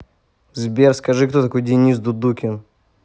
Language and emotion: Russian, angry